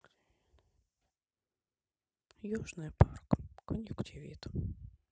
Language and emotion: Russian, sad